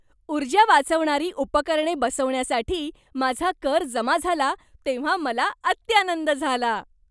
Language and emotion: Marathi, happy